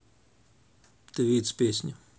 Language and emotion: Russian, neutral